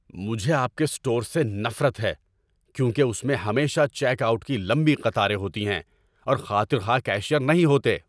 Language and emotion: Urdu, angry